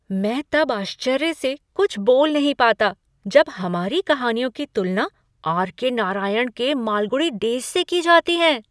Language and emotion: Hindi, surprised